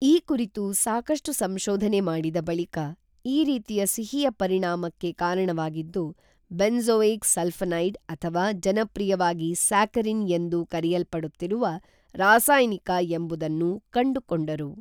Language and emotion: Kannada, neutral